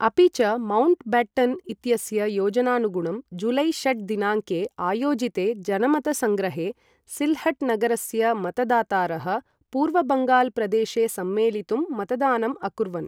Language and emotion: Sanskrit, neutral